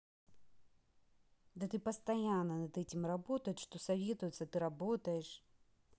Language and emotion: Russian, angry